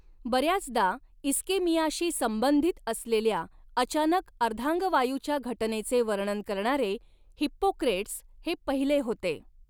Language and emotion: Marathi, neutral